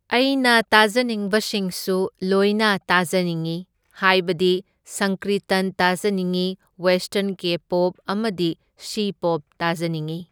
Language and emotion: Manipuri, neutral